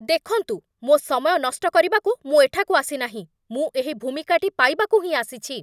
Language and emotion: Odia, angry